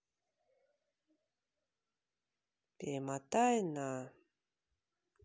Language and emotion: Russian, neutral